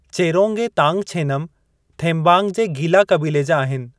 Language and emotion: Sindhi, neutral